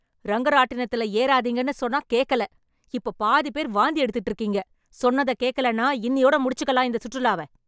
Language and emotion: Tamil, angry